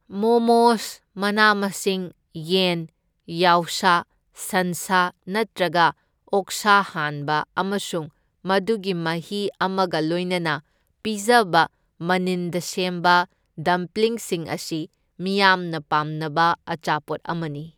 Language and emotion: Manipuri, neutral